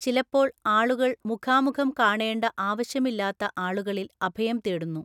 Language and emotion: Malayalam, neutral